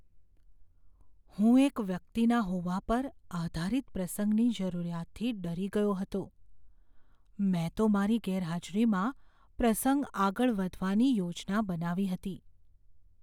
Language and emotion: Gujarati, fearful